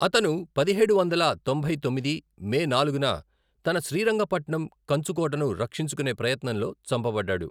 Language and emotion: Telugu, neutral